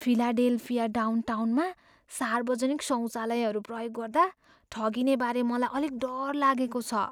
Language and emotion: Nepali, fearful